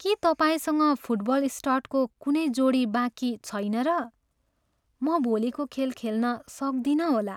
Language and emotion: Nepali, sad